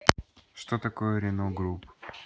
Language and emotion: Russian, neutral